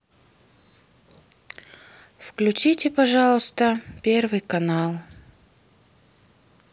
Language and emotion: Russian, sad